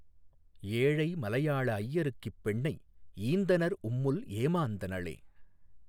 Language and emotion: Tamil, neutral